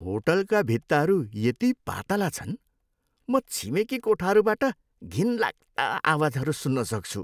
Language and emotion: Nepali, disgusted